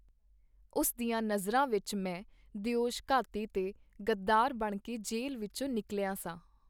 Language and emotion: Punjabi, neutral